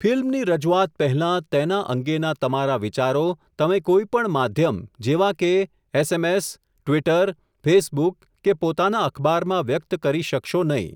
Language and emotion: Gujarati, neutral